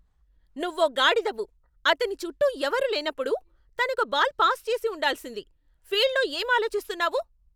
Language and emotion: Telugu, angry